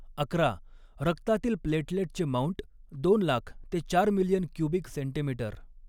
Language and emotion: Marathi, neutral